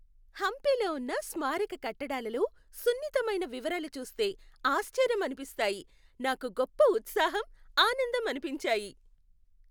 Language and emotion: Telugu, happy